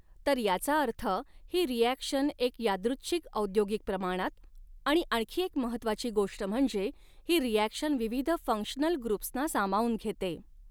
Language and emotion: Marathi, neutral